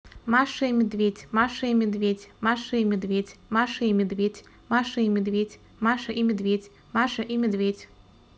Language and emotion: Russian, neutral